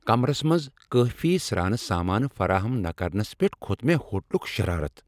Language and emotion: Kashmiri, angry